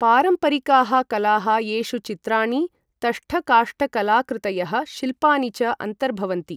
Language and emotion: Sanskrit, neutral